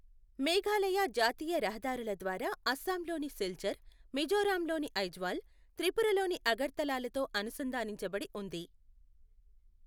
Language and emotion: Telugu, neutral